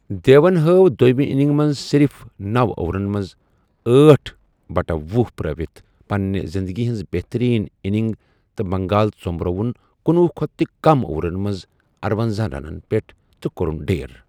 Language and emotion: Kashmiri, neutral